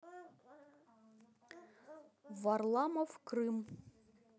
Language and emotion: Russian, neutral